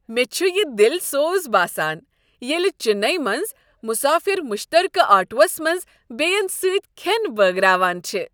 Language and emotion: Kashmiri, happy